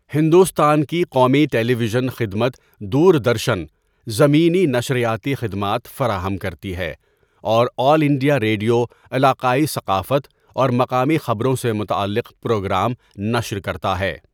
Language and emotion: Urdu, neutral